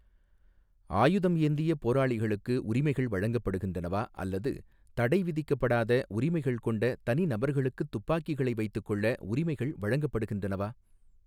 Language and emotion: Tamil, neutral